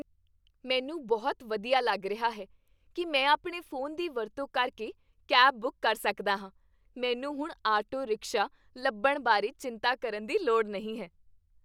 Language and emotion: Punjabi, happy